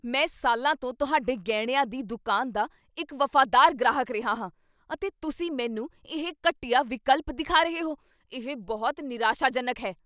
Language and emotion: Punjabi, angry